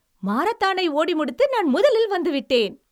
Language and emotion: Tamil, happy